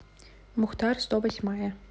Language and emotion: Russian, neutral